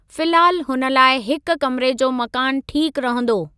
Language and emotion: Sindhi, neutral